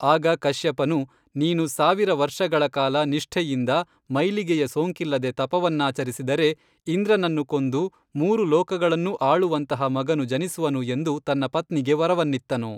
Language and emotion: Kannada, neutral